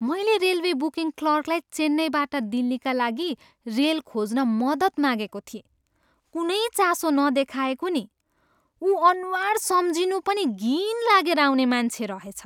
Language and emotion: Nepali, disgusted